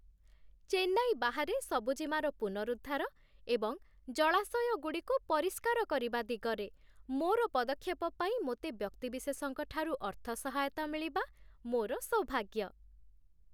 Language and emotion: Odia, happy